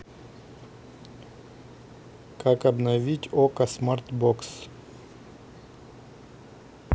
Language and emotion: Russian, neutral